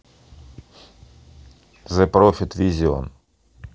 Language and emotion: Russian, neutral